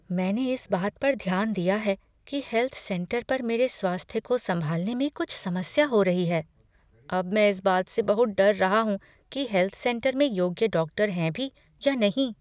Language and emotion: Hindi, fearful